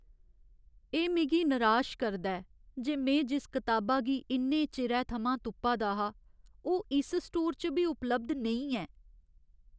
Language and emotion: Dogri, sad